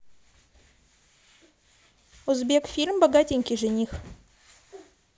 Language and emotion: Russian, neutral